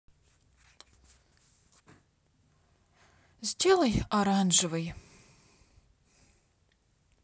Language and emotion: Russian, sad